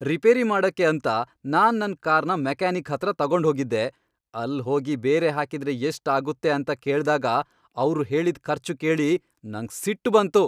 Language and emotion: Kannada, angry